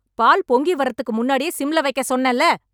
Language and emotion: Tamil, angry